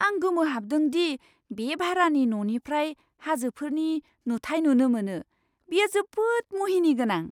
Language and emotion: Bodo, surprised